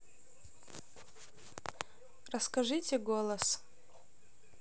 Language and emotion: Russian, neutral